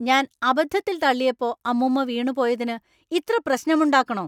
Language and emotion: Malayalam, angry